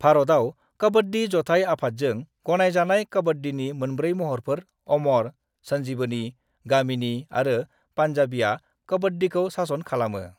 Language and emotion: Bodo, neutral